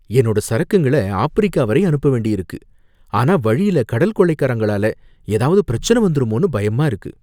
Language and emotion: Tamil, fearful